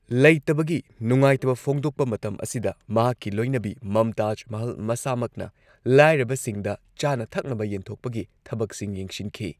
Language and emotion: Manipuri, neutral